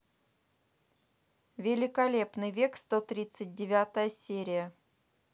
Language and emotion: Russian, neutral